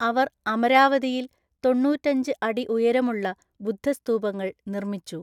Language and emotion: Malayalam, neutral